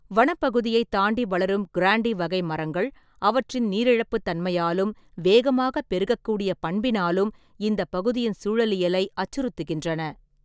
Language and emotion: Tamil, neutral